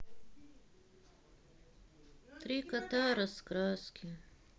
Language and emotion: Russian, sad